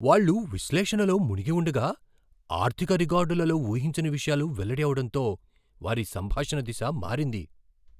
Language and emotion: Telugu, surprised